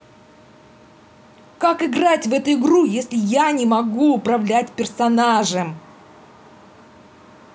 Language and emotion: Russian, angry